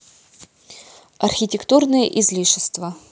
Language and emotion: Russian, neutral